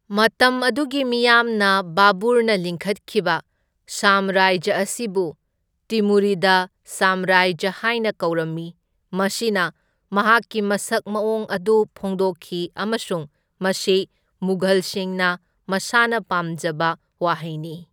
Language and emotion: Manipuri, neutral